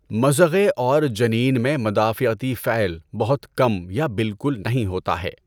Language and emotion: Urdu, neutral